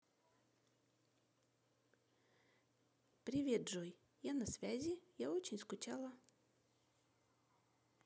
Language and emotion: Russian, neutral